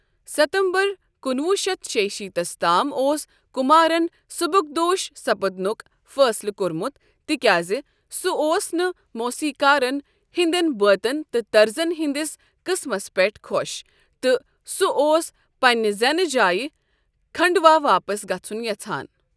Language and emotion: Kashmiri, neutral